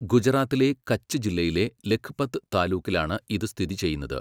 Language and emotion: Malayalam, neutral